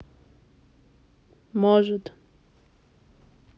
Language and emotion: Russian, sad